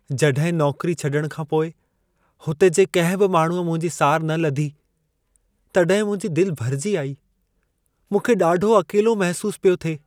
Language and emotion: Sindhi, sad